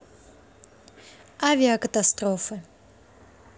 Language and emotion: Russian, neutral